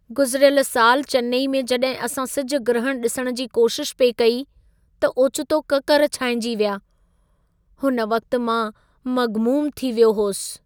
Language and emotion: Sindhi, sad